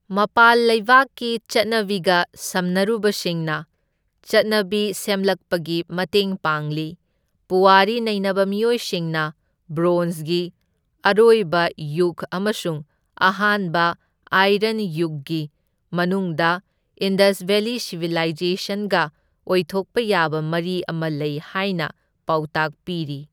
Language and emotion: Manipuri, neutral